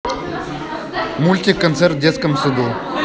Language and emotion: Russian, neutral